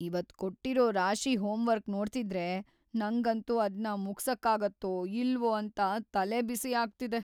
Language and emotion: Kannada, fearful